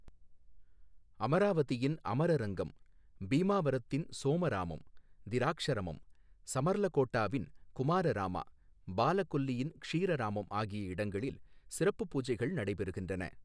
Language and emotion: Tamil, neutral